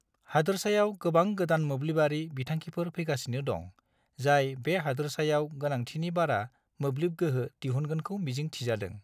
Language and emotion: Bodo, neutral